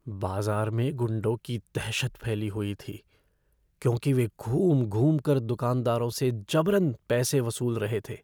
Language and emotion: Hindi, fearful